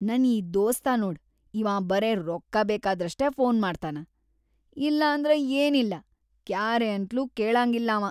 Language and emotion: Kannada, disgusted